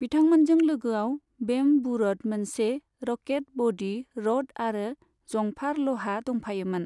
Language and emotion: Bodo, neutral